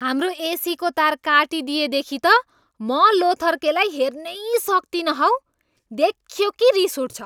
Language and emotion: Nepali, angry